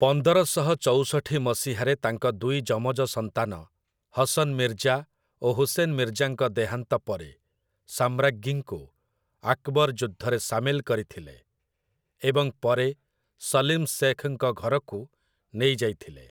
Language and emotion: Odia, neutral